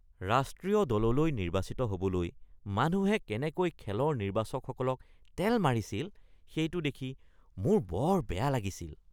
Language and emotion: Assamese, disgusted